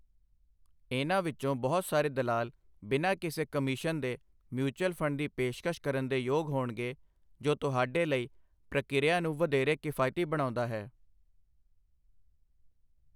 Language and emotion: Punjabi, neutral